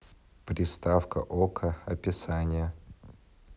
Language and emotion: Russian, neutral